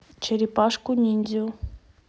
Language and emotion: Russian, neutral